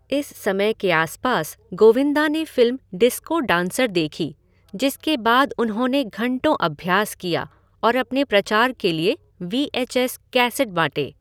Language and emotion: Hindi, neutral